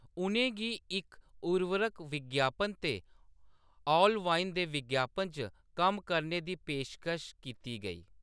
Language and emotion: Dogri, neutral